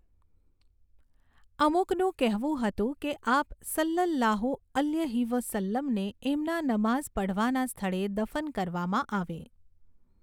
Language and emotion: Gujarati, neutral